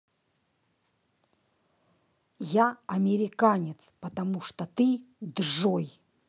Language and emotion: Russian, angry